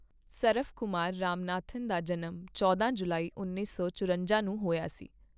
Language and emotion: Punjabi, neutral